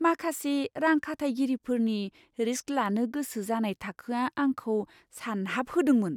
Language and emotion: Bodo, surprised